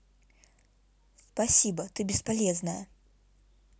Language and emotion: Russian, angry